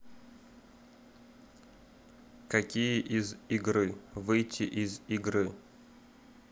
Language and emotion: Russian, neutral